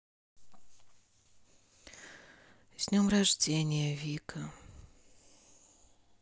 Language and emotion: Russian, sad